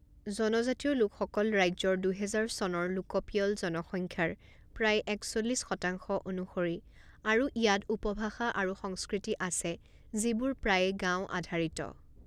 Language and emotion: Assamese, neutral